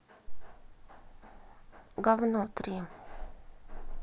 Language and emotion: Russian, neutral